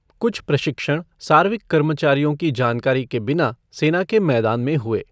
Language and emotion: Hindi, neutral